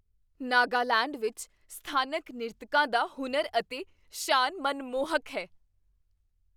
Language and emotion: Punjabi, surprised